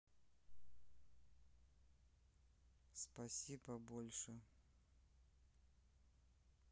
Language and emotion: Russian, neutral